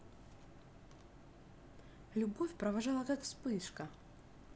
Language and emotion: Russian, neutral